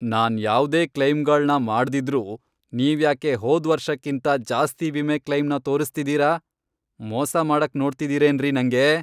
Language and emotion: Kannada, angry